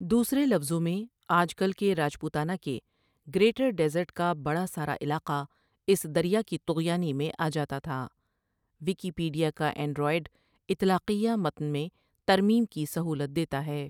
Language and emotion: Urdu, neutral